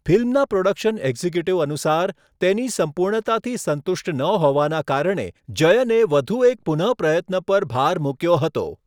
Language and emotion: Gujarati, neutral